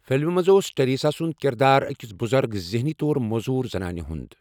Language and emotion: Kashmiri, neutral